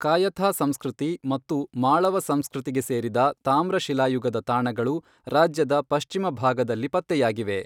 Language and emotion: Kannada, neutral